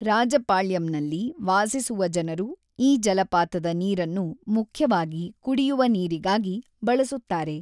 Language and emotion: Kannada, neutral